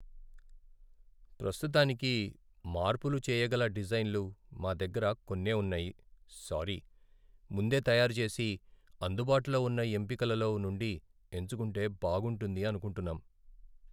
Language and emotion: Telugu, sad